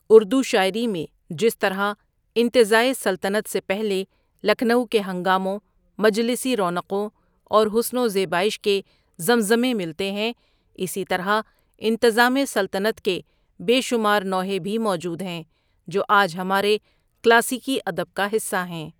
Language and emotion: Urdu, neutral